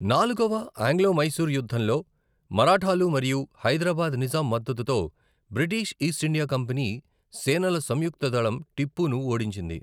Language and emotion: Telugu, neutral